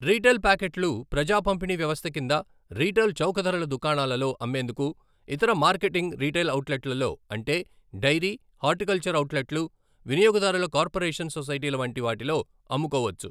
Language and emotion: Telugu, neutral